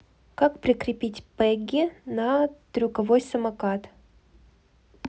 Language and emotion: Russian, neutral